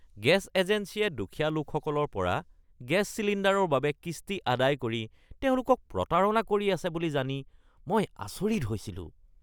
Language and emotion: Assamese, disgusted